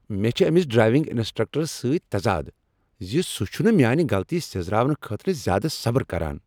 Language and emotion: Kashmiri, angry